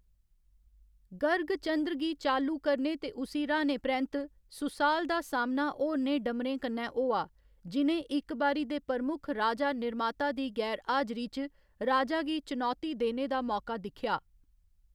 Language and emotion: Dogri, neutral